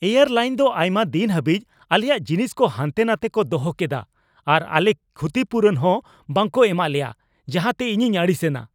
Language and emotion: Santali, angry